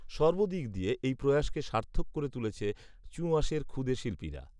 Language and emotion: Bengali, neutral